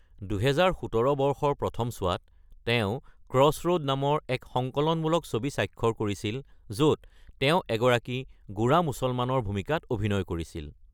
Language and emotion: Assamese, neutral